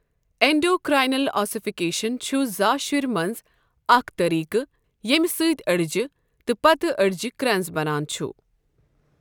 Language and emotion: Kashmiri, neutral